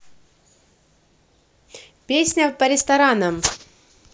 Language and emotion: Russian, positive